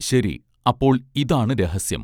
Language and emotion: Malayalam, neutral